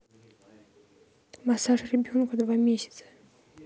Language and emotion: Russian, neutral